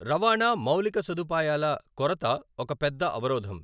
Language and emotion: Telugu, neutral